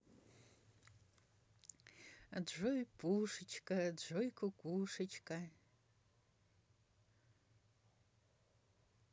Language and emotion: Russian, positive